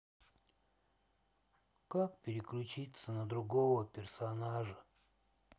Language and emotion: Russian, sad